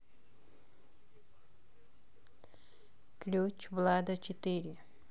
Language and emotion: Russian, neutral